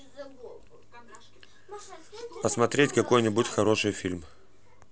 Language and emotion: Russian, neutral